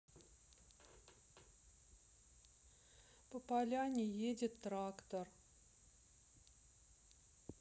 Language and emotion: Russian, sad